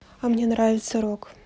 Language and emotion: Russian, neutral